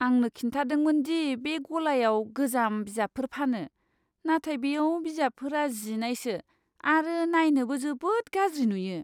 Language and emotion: Bodo, disgusted